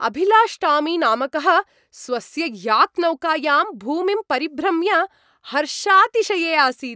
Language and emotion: Sanskrit, happy